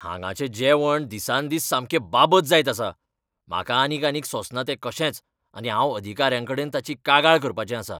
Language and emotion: Goan Konkani, angry